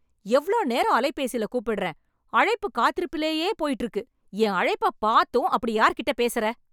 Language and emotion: Tamil, angry